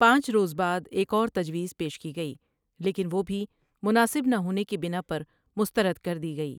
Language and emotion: Urdu, neutral